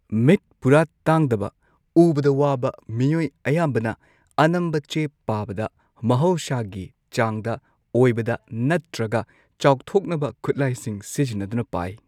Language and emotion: Manipuri, neutral